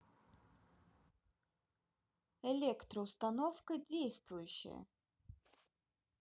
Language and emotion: Russian, neutral